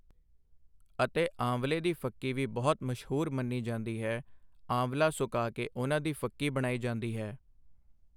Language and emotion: Punjabi, neutral